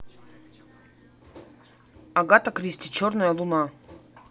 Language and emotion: Russian, neutral